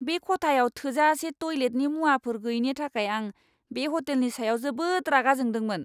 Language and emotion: Bodo, angry